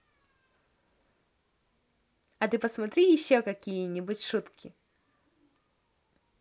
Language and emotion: Russian, positive